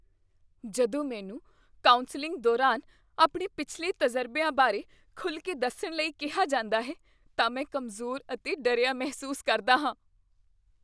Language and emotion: Punjabi, fearful